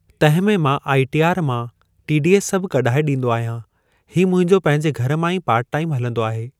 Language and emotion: Sindhi, neutral